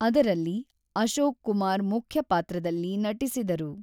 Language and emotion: Kannada, neutral